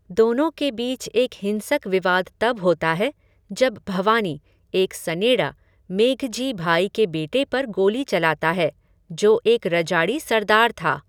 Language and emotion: Hindi, neutral